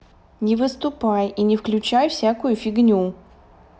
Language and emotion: Russian, neutral